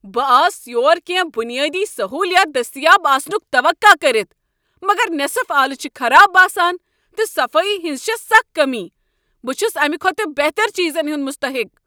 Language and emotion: Kashmiri, angry